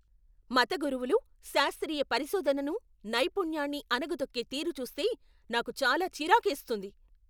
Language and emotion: Telugu, angry